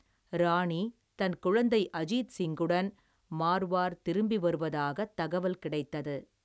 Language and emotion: Tamil, neutral